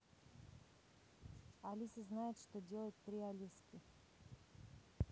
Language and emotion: Russian, neutral